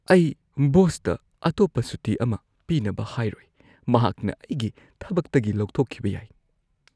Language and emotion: Manipuri, fearful